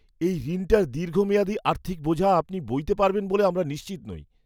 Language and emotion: Bengali, fearful